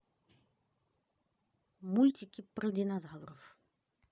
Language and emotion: Russian, neutral